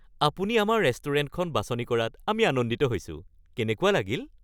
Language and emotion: Assamese, happy